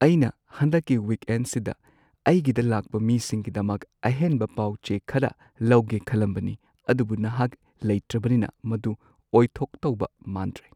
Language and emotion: Manipuri, sad